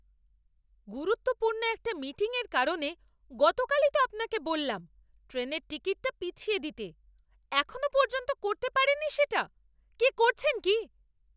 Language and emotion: Bengali, angry